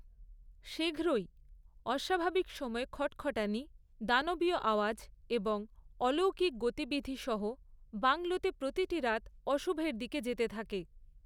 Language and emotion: Bengali, neutral